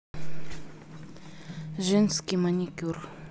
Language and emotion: Russian, neutral